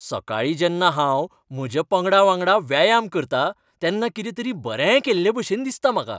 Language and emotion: Goan Konkani, happy